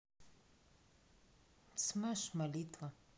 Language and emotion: Russian, neutral